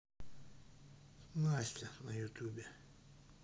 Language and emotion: Russian, sad